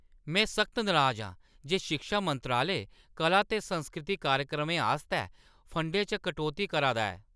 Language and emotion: Dogri, angry